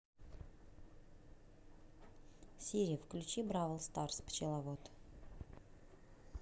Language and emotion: Russian, neutral